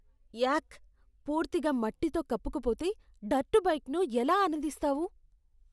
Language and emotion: Telugu, disgusted